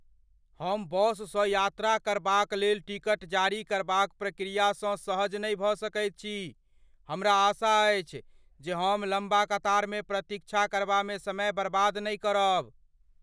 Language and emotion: Maithili, fearful